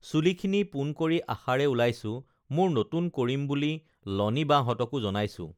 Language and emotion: Assamese, neutral